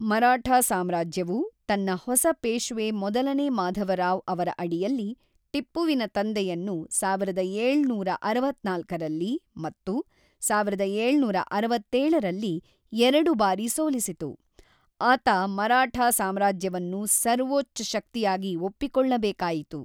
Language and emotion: Kannada, neutral